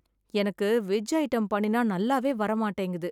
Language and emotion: Tamil, sad